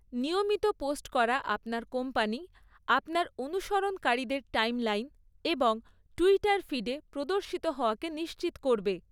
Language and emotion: Bengali, neutral